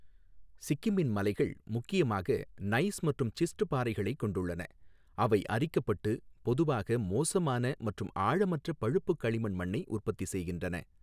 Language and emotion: Tamil, neutral